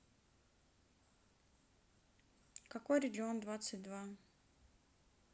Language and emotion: Russian, neutral